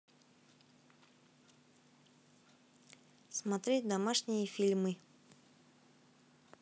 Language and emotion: Russian, neutral